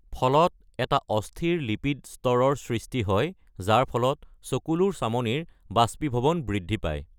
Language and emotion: Assamese, neutral